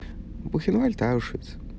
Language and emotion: Russian, neutral